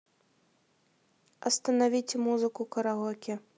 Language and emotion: Russian, neutral